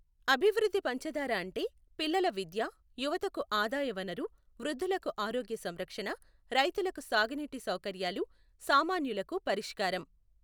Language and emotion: Telugu, neutral